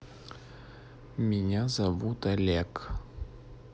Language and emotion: Russian, neutral